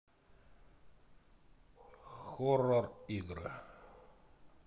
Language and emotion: Russian, neutral